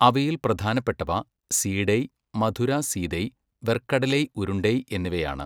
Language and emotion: Malayalam, neutral